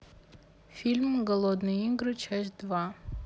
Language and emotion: Russian, neutral